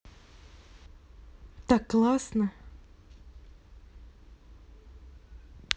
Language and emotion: Russian, positive